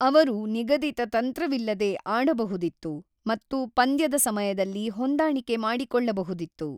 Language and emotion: Kannada, neutral